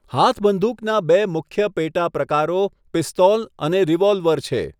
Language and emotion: Gujarati, neutral